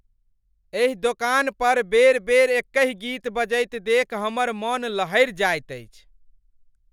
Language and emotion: Maithili, angry